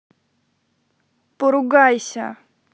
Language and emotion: Russian, neutral